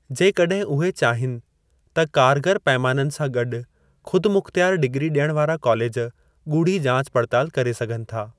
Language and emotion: Sindhi, neutral